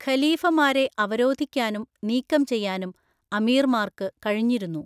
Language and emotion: Malayalam, neutral